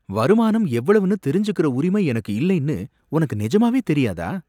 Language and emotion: Tamil, surprised